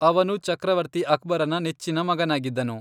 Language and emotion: Kannada, neutral